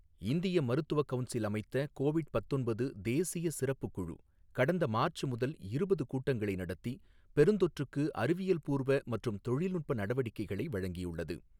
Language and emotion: Tamil, neutral